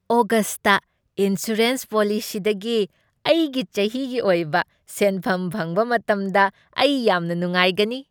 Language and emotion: Manipuri, happy